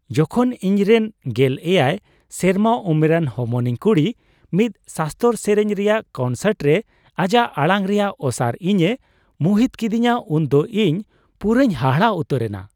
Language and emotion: Santali, surprised